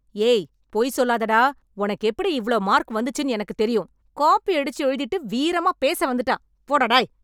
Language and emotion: Tamil, angry